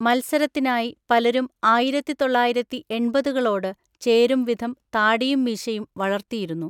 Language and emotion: Malayalam, neutral